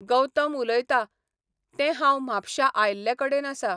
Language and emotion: Goan Konkani, neutral